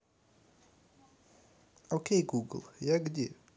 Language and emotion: Russian, neutral